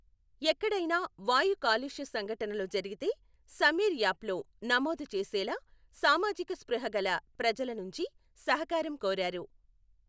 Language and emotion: Telugu, neutral